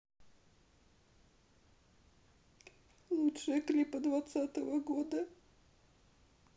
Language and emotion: Russian, sad